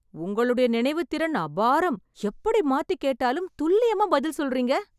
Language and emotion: Tamil, surprised